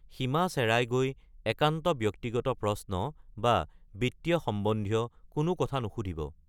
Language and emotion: Assamese, neutral